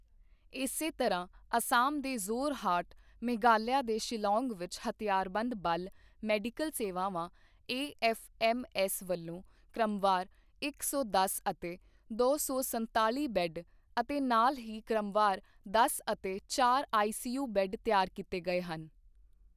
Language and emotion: Punjabi, neutral